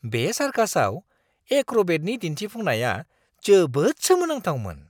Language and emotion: Bodo, surprised